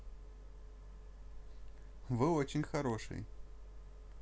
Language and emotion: Russian, positive